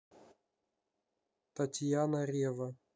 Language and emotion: Russian, neutral